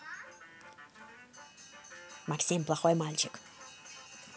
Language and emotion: Russian, angry